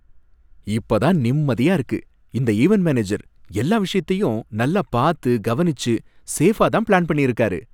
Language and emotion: Tamil, happy